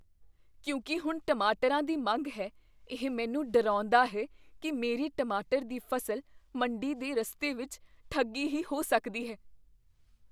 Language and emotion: Punjabi, fearful